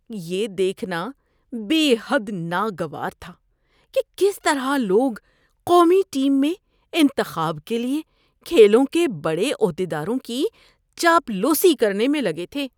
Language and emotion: Urdu, disgusted